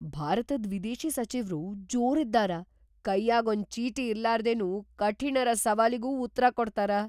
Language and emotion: Kannada, surprised